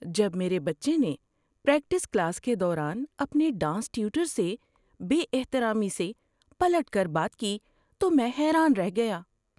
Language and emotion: Urdu, surprised